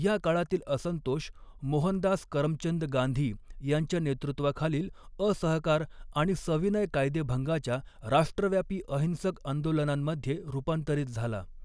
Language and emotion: Marathi, neutral